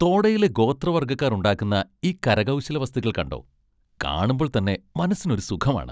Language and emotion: Malayalam, happy